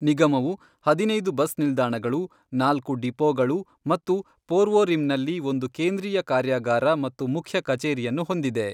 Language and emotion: Kannada, neutral